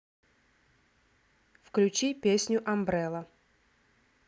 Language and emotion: Russian, neutral